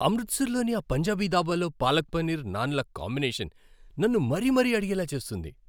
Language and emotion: Telugu, happy